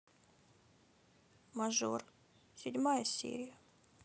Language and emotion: Russian, sad